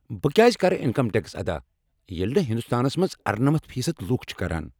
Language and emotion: Kashmiri, angry